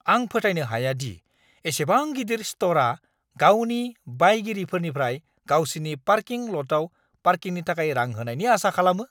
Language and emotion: Bodo, angry